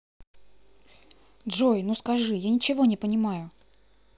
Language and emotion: Russian, neutral